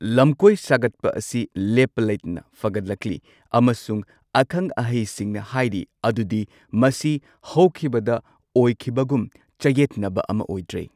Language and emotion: Manipuri, neutral